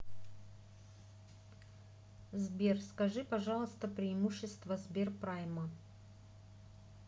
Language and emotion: Russian, neutral